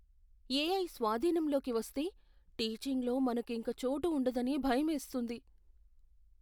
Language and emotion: Telugu, fearful